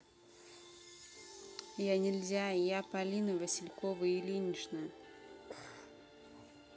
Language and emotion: Russian, neutral